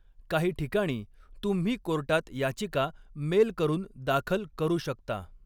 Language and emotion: Marathi, neutral